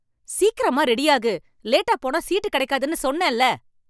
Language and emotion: Tamil, angry